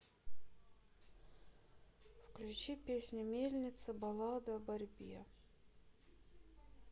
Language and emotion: Russian, neutral